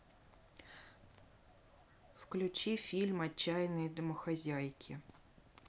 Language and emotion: Russian, neutral